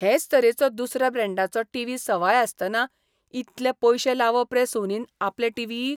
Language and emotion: Goan Konkani, disgusted